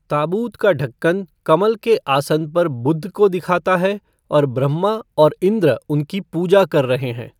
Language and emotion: Hindi, neutral